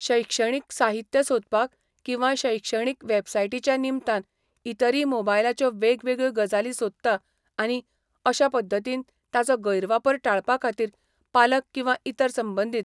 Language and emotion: Goan Konkani, neutral